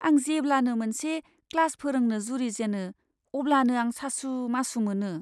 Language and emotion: Bodo, fearful